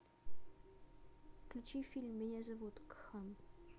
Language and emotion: Russian, neutral